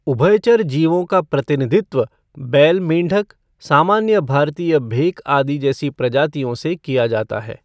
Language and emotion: Hindi, neutral